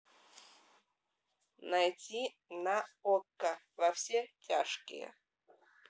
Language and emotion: Russian, neutral